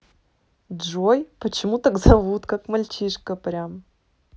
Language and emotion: Russian, positive